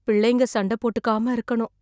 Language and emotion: Tamil, fearful